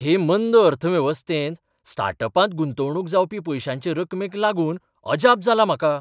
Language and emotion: Goan Konkani, surprised